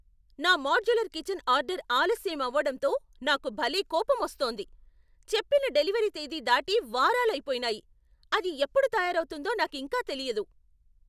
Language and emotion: Telugu, angry